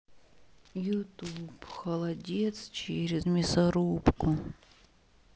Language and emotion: Russian, sad